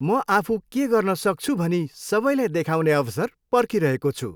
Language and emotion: Nepali, happy